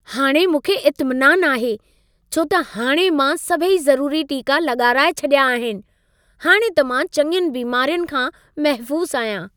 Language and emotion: Sindhi, happy